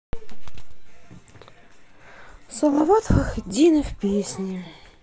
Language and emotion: Russian, sad